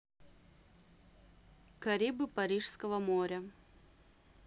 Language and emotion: Russian, neutral